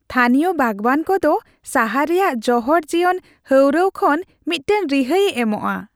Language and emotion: Santali, happy